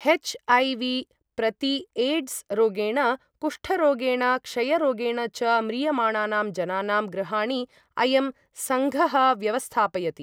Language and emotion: Sanskrit, neutral